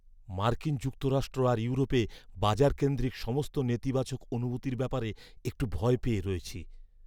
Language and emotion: Bengali, fearful